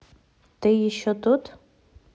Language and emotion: Russian, neutral